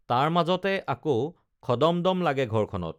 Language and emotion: Assamese, neutral